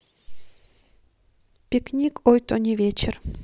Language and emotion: Russian, neutral